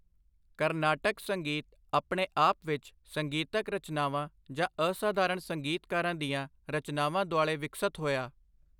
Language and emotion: Punjabi, neutral